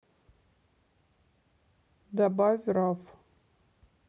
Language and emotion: Russian, neutral